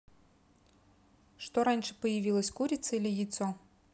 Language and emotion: Russian, neutral